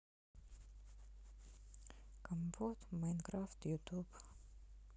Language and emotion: Russian, sad